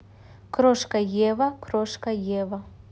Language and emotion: Russian, neutral